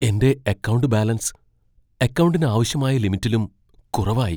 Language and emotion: Malayalam, fearful